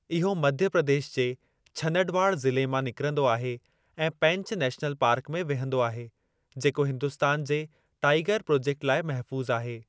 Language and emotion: Sindhi, neutral